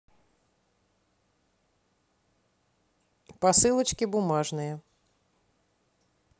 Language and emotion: Russian, neutral